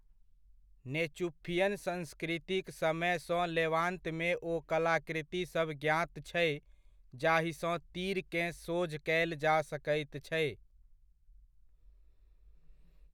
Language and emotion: Maithili, neutral